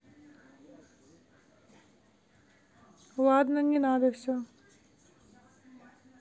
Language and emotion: Russian, neutral